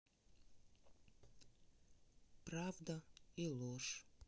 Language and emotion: Russian, sad